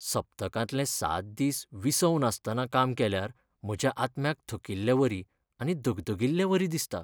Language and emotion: Goan Konkani, sad